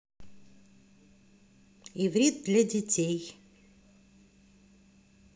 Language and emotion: Russian, positive